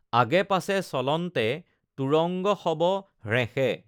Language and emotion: Assamese, neutral